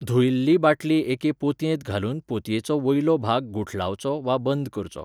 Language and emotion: Goan Konkani, neutral